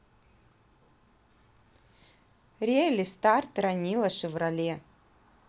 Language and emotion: Russian, neutral